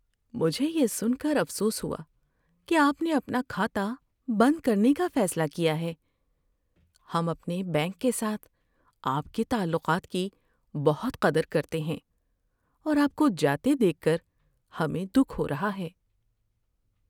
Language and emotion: Urdu, sad